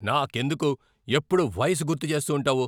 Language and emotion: Telugu, angry